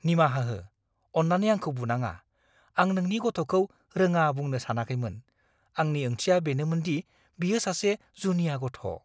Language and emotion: Bodo, fearful